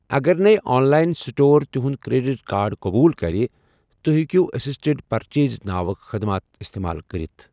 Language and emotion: Kashmiri, neutral